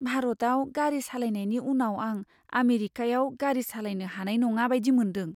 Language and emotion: Bodo, fearful